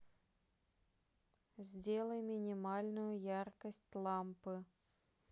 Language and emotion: Russian, neutral